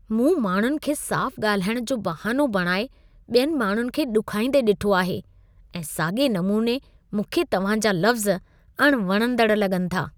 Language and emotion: Sindhi, disgusted